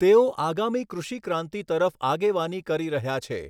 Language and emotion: Gujarati, neutral